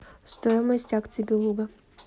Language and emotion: Russian, neutral